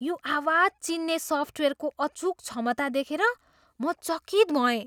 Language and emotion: Nepali, surprised